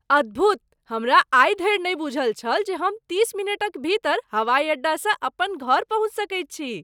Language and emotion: Maithili, surprised